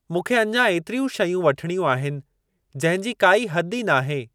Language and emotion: Sindhi, neutral